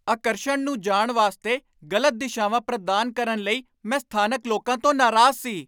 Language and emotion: Punjabi, angry